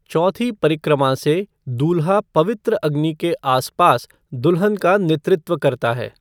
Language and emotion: Hindi, neutral